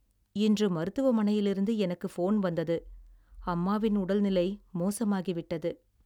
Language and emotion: Tamil, sad